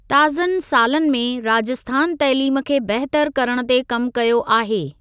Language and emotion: Sindhi, neutral